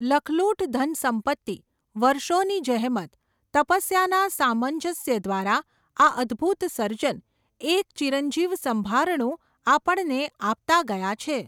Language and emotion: Gujarati, neutral